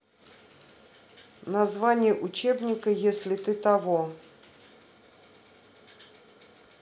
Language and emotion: Russian, neutral